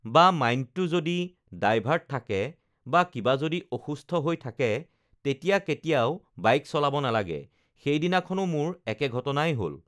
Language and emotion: Assamese, neutral